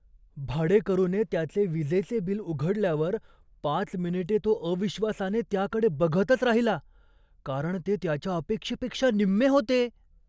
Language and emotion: Marathi, surprised